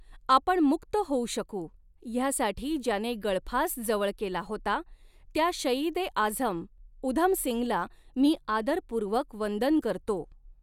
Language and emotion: Marathi, neutral